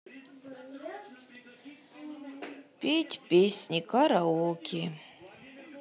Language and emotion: Russian, sad